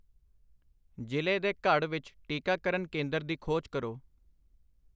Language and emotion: Punjabi, neutral